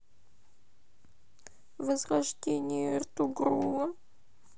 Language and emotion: Russian, sad